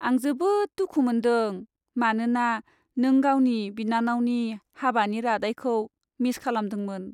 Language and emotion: Bodo, sad